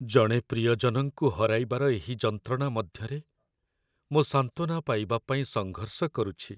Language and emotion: Odia, sad